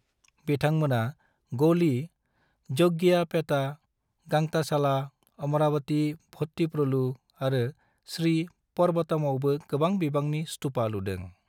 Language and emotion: Bodo, neutral